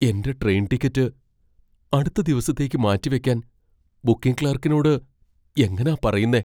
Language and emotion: Malayalam, fearful